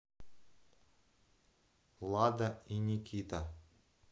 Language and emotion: Russian, neutral